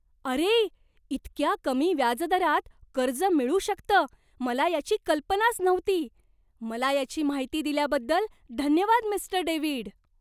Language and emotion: Marathi, surprised